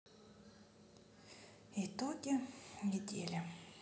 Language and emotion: Russian, sad